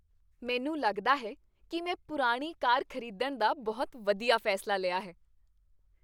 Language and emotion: Punjabi, happy